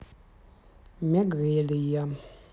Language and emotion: Russian, neutral